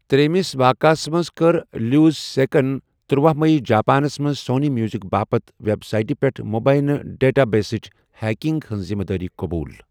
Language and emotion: Kashmiri, neutral